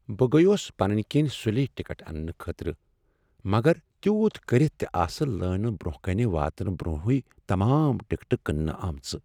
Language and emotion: Kashmiri, sad